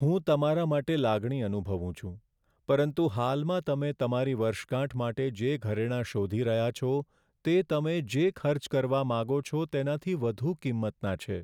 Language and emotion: Gujarati, sad